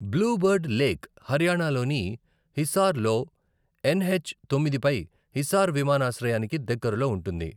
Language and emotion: Telugu, neutral